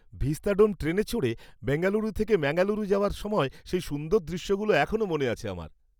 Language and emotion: Bengali, happy